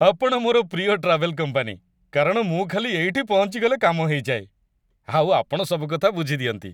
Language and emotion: Odia, happy